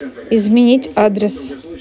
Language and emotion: Russian, neutral